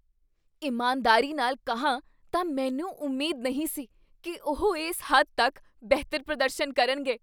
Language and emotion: Punjabi, surprised